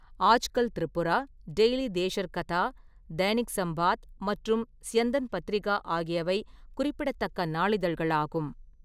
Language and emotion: Tamil, neutral